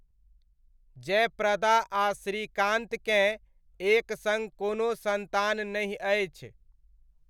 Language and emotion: Maithili, neutral